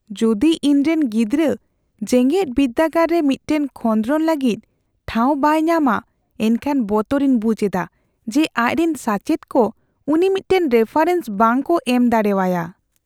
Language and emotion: Santali, fearful